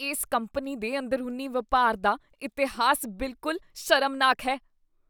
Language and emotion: Punjabi, disgusted